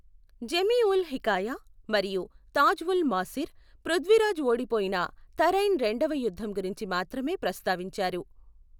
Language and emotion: Telugu, neutral